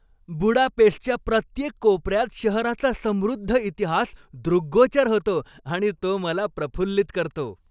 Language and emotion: Marathi, happy